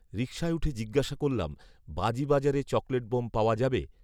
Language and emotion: Bengali, neutral